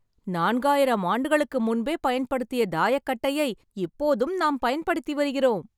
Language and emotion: Tamil, happy